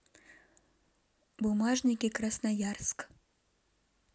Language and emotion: Russian, neutral